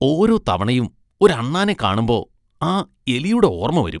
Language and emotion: Malayalam, disgusted